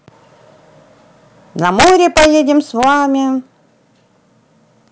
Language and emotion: Russian, positive